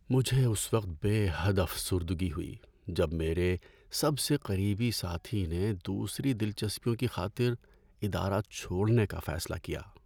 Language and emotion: Urdu, sad